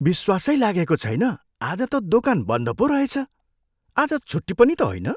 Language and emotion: Nepali, surprised